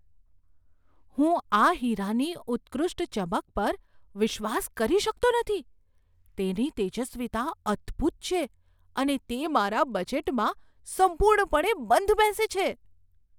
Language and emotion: Gujarati, surprised